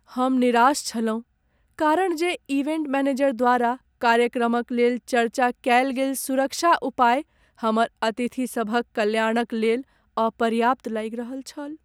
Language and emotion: Maithili, sad